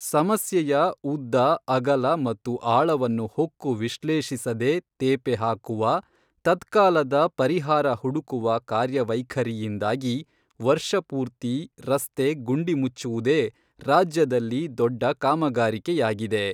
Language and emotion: Kannada, neutral